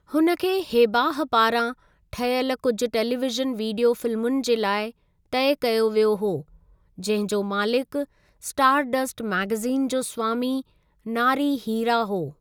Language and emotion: Sindhi, neutral